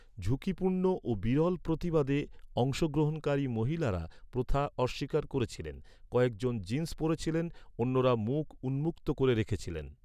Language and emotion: Bengali, neutral